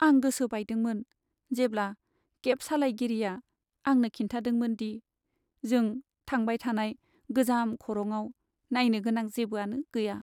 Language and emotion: Bodo, sad